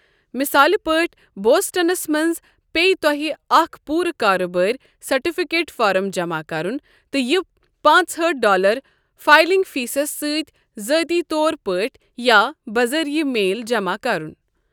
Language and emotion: Kashmiri, neutral